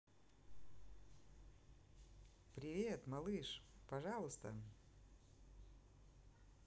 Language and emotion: Russian, positive